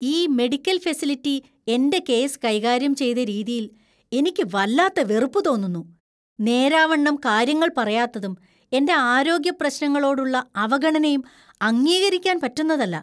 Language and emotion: Malayalam, disgusted